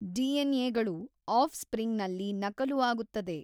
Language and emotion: Kannada, neutral